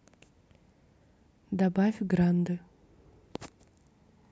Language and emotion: Russian, neutral